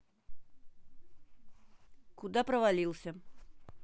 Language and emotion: Russian, neutral